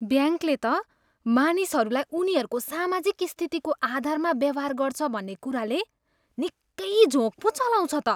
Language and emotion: Nepali, disgusted